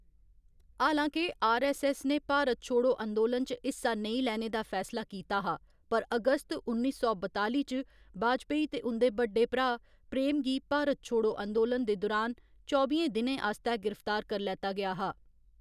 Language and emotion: Dogri, neutral